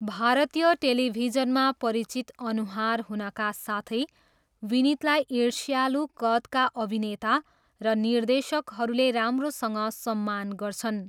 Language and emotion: Nepali, neutral